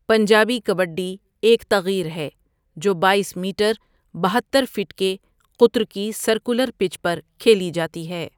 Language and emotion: Urdu, neutral